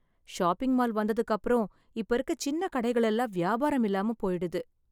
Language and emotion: Tamil, sad